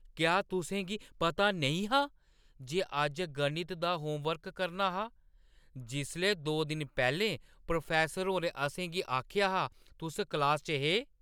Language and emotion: Dogri, surprised